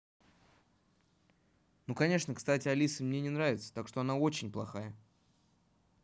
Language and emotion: Russian, neutral